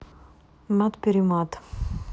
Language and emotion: Russian, neutral